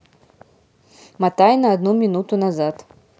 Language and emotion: Russian, neutral